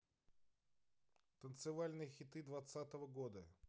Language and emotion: Russian, neutral